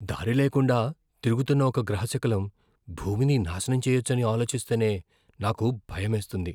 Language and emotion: Telugu, fearful